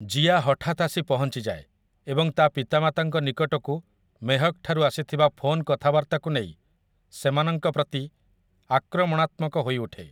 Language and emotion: Odia, neutral